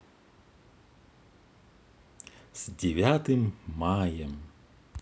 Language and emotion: Russian, positive